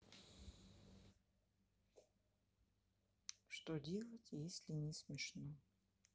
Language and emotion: Russian, neutral